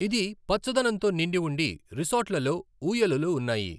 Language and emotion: Telugu, neutral